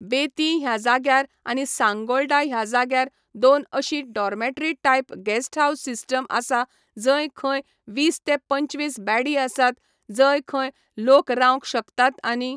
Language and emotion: Goan Konkani, neutral